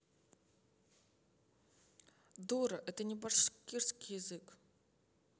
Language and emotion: Russian, angry